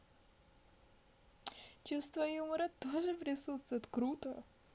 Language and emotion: Russian, positive